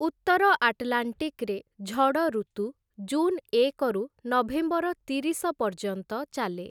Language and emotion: Odia, neutral